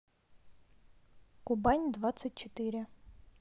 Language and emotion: Russian, neutral